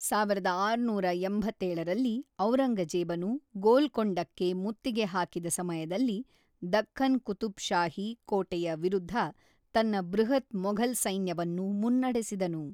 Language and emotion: Kannada, neutral